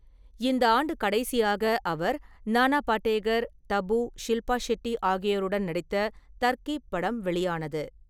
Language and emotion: Tamil, neutral